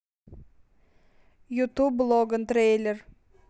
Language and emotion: Russian, neutral